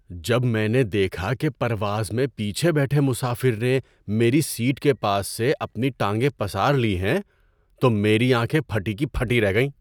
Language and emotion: Urdu, surprised